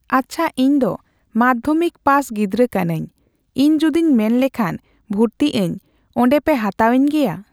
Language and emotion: Santali, neutral